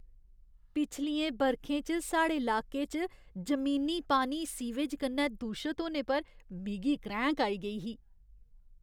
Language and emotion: Dogri, disgusted